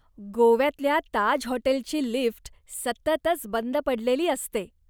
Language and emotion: Marathi, disgusted